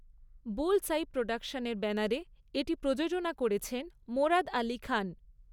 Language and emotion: Bengali, neutral